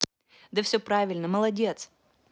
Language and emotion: Russian, positive